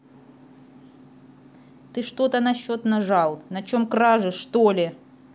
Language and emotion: Russian, angry